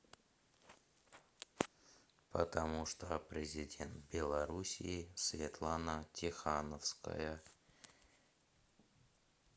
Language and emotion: Russian, neutral